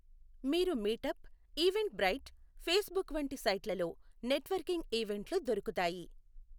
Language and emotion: Telugu, neutral